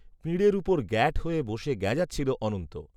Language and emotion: Bengali, neutral